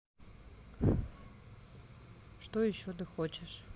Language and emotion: Russian, neutral